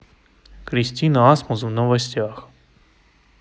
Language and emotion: Russian, neutral